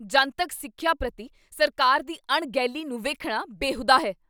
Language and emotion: Punjabi, angry